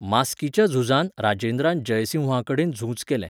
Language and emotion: Goan Konkani, neutral